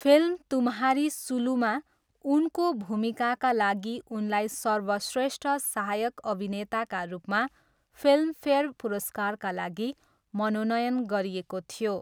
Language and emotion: Nepali, neutral